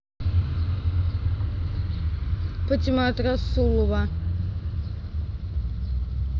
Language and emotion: Russian, neutral